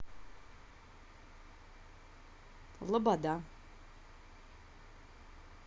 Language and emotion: Russian, neutral